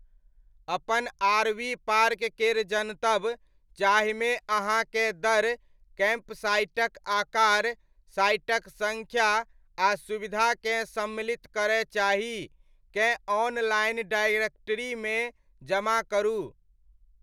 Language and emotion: Maithili, neutral